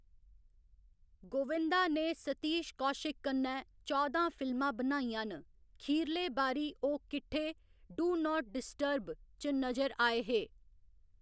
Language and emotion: Dogri, neutral